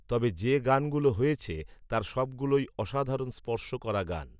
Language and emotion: Bengali, neutral